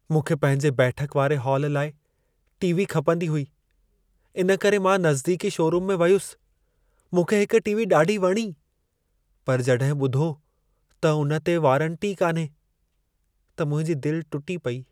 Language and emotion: Sindhi, sad